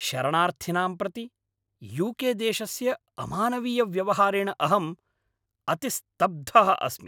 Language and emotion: Sanskrit, angry